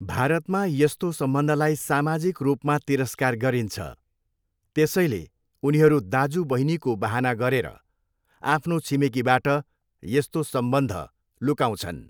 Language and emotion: Nepali, neutral